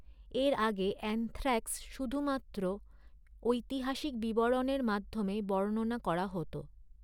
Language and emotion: Bengali, neutral